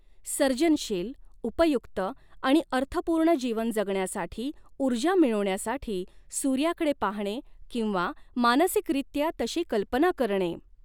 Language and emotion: Marathi, neutral